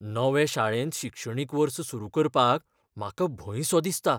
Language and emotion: Goan Konkani, fearful